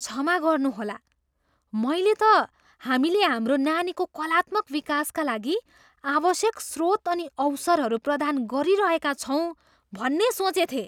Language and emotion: Nepali, surprised